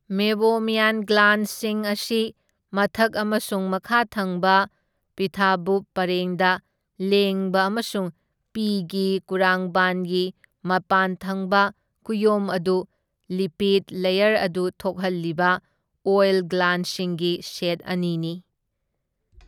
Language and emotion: Manipuri, neutral